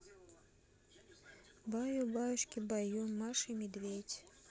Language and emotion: Russian, neutral